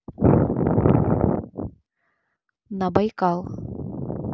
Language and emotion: Russian, neutral